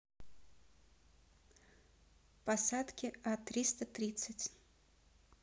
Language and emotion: Russian, neutral